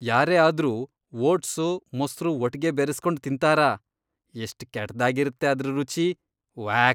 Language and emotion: Kannada, disgusted